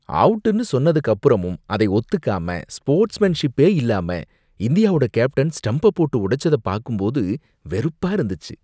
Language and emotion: Tamil, disgusted